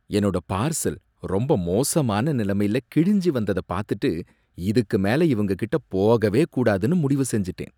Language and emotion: Tamil, disgusted